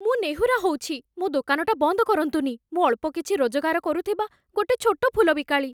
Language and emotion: Odia, fearful